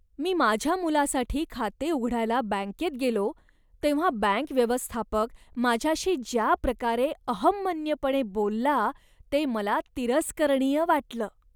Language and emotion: Marathi, disgusted